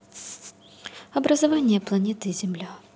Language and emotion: Russian, neutral